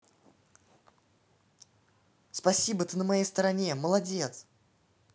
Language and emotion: Russian, positive